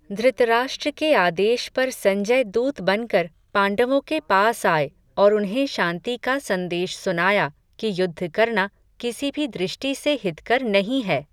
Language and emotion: Hindi, neutral